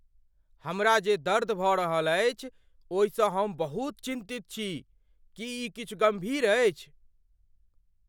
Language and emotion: Maithili, fearful